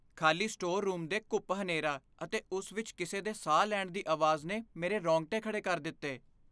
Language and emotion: Punjabi, fearful